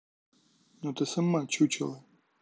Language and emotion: Russian, angry